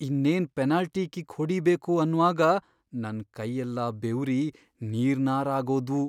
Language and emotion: Kannada, fearful